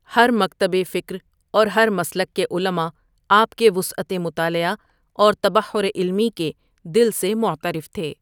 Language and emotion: Urdu, neutral